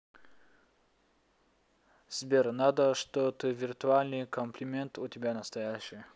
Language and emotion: Russian, neutral